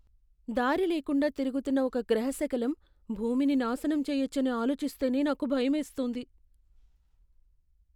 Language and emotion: Telugu, fearful